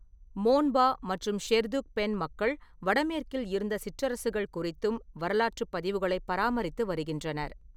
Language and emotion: Tamil, neutral